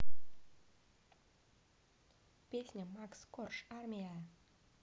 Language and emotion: Russian, neutral